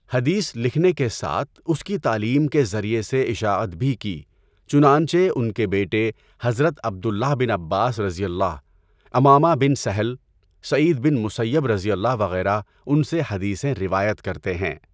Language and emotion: Urdu, neutral